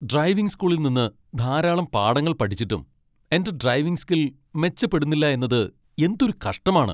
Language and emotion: Malayalam, angry